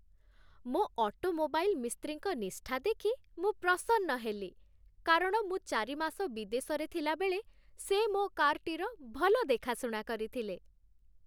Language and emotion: Odia, happy